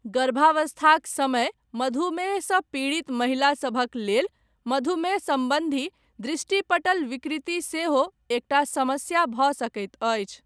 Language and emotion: Maithili, neutral